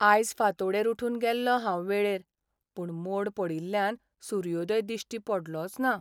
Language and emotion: Goan Konkani, sad